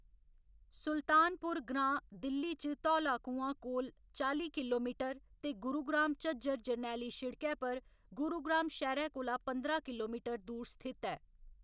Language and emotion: Dogri, neutral